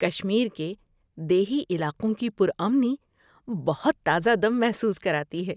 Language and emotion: Urdu, happy